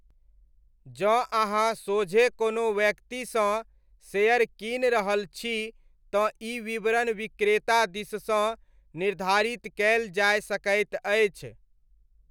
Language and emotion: Maithili, neutral